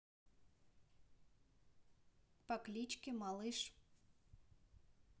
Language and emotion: Russian, neutral